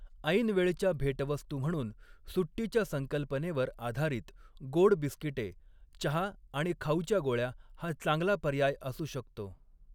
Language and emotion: Marathi, neutral